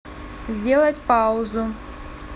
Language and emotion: Russian, neutral